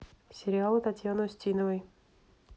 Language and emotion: Russian, neutral